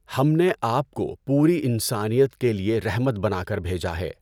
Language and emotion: Urdu, neutral